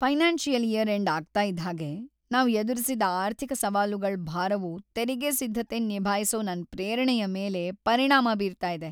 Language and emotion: Kannada, sad